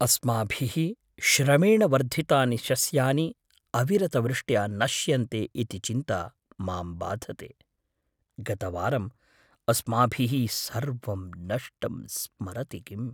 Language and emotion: Sanskrit, fearful